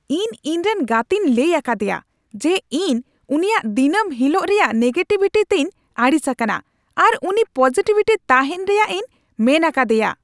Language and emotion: Santali, angry